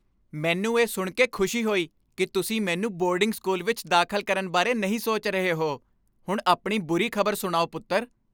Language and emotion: Punjabi, happy